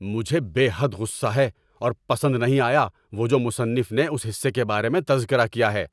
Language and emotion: Urdu, angry